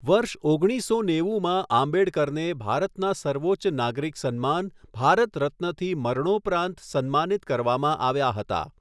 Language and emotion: Gujarati, neutral